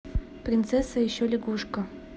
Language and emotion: Russian, neutral